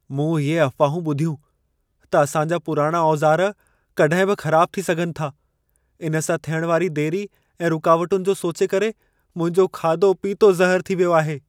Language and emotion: Sindhi, fearful